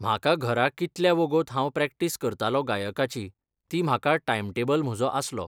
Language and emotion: Goan Konkani, neutral